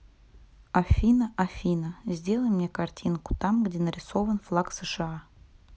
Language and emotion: Russian, neutral